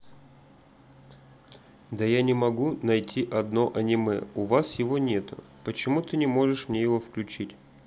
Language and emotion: Russian, neutral